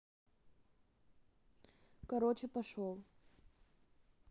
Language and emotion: Russian, neutral